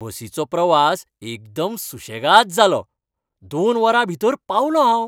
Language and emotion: Goan Konkani, happy